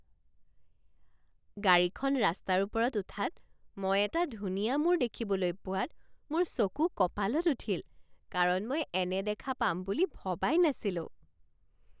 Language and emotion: Assamese, surprised